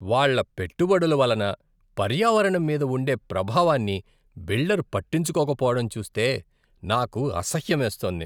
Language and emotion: Telugu, disgusted